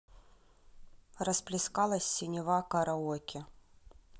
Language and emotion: Russian, neutral